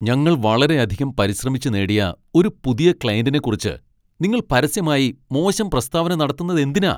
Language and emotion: Malayalam, angry